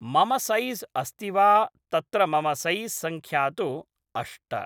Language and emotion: Sanskrit, neutral